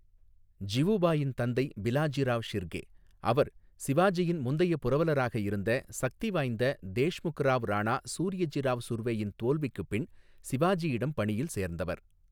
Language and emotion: Tamil, neutral